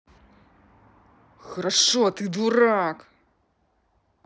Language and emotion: Russian, angry